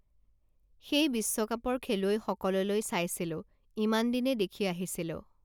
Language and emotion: Assamese, neutral